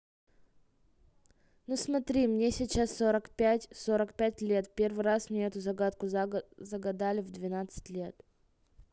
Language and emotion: Russian, neutral